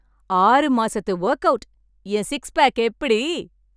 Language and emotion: Tamil, happy